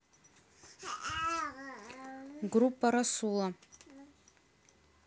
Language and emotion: Russian, neutral